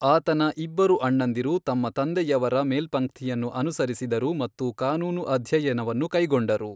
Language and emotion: Kannada, neutral